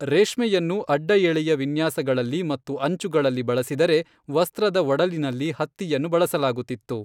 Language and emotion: Kannada, neutral